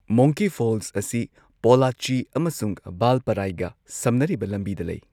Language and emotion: Manipuri, neutral